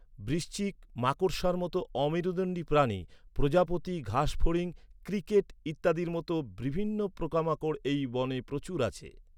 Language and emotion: Bengali, neutral